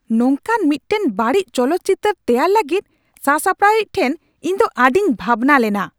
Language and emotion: Santali, angry